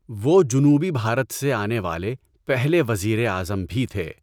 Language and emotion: Urdu, neutral